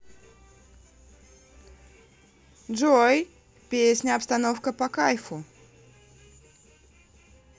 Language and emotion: Russian, positive